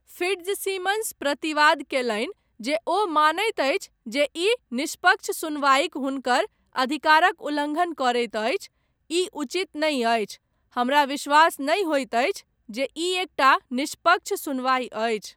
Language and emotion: Maithili, neutral